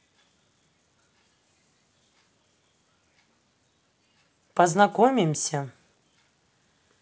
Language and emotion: Russian, neutral